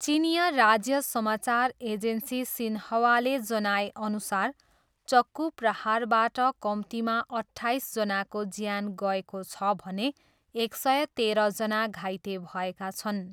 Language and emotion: Nepali, neutral